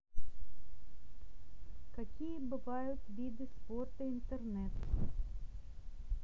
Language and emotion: Russian, neutral